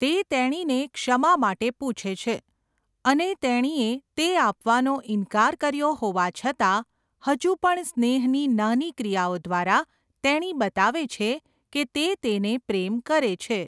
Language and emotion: Gujarati, neutral